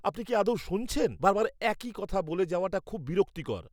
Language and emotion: Bengali, angry